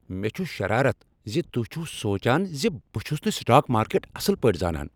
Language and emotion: Kashmiri, angry